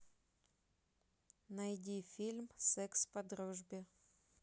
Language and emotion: Russian, neutral